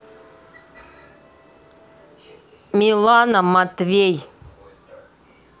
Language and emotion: Russian, neutral